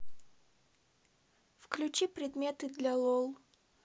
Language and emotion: Russian, neutral